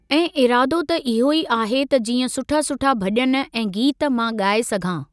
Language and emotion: Sindhi, neutral